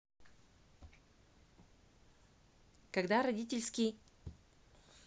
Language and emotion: Russian, neutral